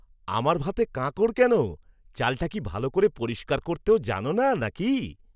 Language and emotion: Bengali, angry